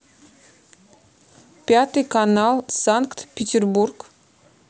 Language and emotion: Russian, neutral